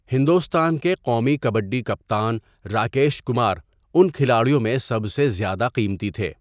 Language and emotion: Urdu, neutral